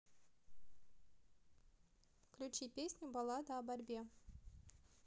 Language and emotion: Russian, neutral